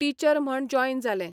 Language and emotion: Goan Konkani, neutral